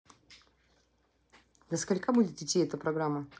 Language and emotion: Russian, neutral